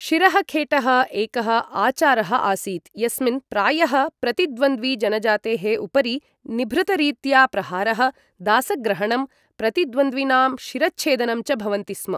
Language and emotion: Sanskrit, neutral